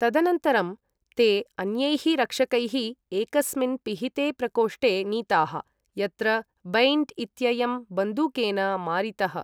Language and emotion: Sanskrit, neutral